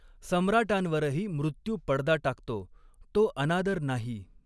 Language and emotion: Marathi, neutral